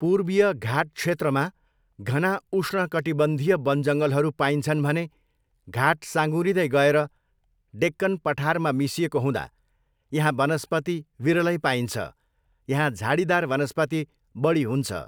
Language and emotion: Nepali, neutral